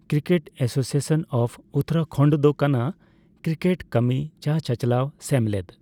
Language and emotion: Santali, neutral